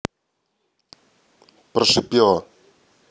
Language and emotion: Russian, neutral